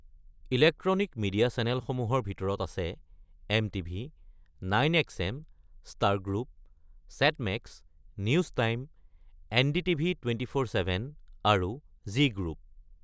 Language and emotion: Assamese, neutral